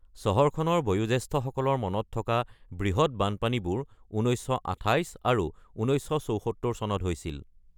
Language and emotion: Assamese, neutral